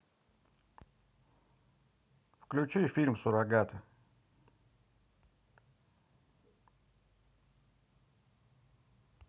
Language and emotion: Russian, neutral